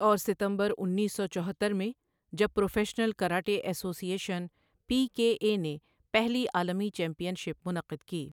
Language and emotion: Urdu, neutral